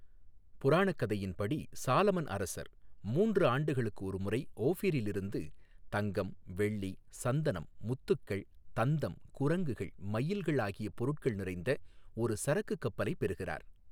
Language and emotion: Tamil, neutral